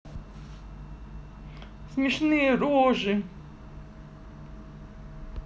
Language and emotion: Russian, neutral